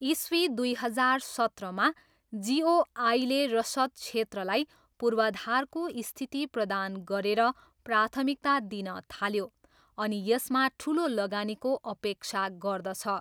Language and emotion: Nepali, neutral